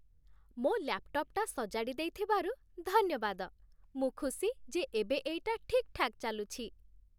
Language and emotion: Odia, happy